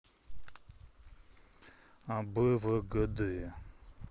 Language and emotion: Russian, neutral